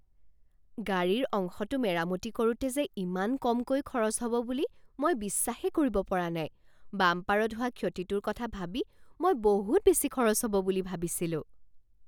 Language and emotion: Assamese, surprised